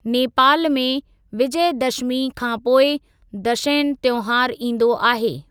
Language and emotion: Sindhi, neutral